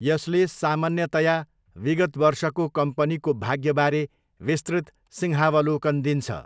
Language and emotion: Nepali, neutral